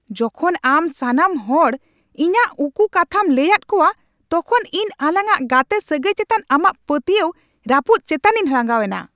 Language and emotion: Santali, angry